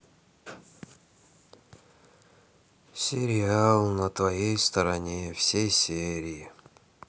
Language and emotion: Russian, sad